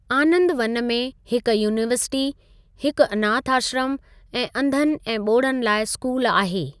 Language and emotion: Sindhi, neutral